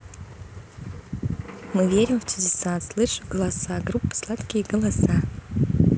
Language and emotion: Russian, neutral